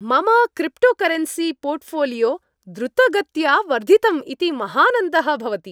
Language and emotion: Sanskrit, happy